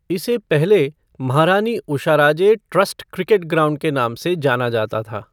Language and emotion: Hindi, neutral